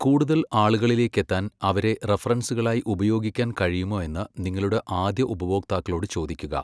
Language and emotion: Malayalam, neutral